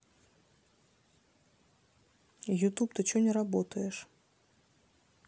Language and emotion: Russian, neutral